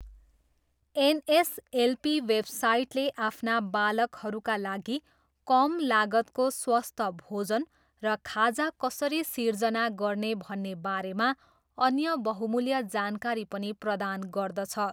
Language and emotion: Nepali, neutral